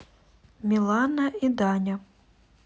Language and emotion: Russian, neutral